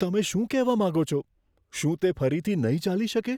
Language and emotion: Gujarati, fearful